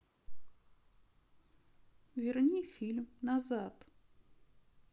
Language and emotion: Russian, sad